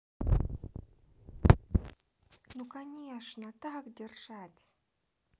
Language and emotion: Russian, positive